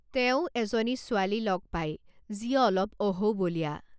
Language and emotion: Assamese, neutral